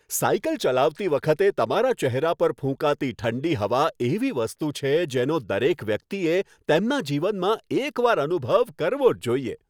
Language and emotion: Gujarati, happy